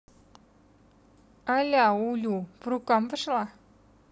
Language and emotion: Russian, neutral